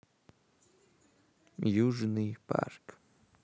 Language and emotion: Russian, neutral